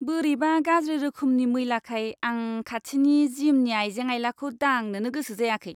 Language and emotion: Bodo, disgusted